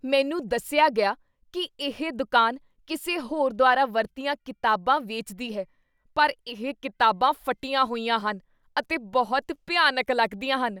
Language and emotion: Punjabi, disgusted